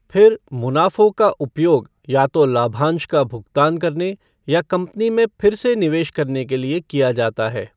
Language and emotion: Hindi, neutral